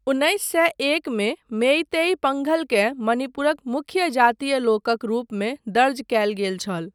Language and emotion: Maithili, neutral